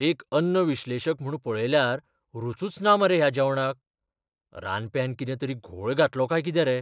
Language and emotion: Goan Konkani, fearful